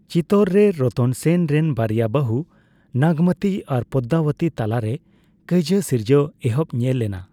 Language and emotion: Santali, neutral